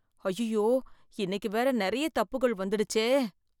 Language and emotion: Tamil, fearful